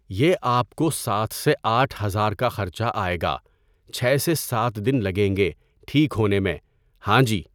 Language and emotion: Urdu, neutral